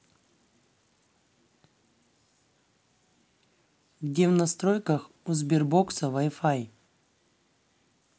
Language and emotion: Russian, neutral